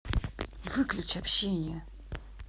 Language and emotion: Russian, angry